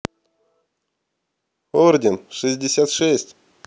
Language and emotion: Russian, positive